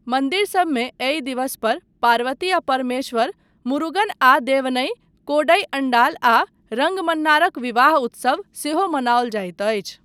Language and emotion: Maithili, neutral